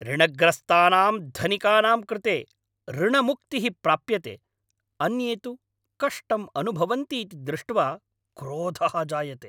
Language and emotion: Sanskrit, angry